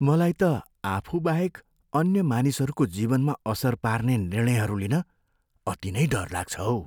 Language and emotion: Nepali, fearful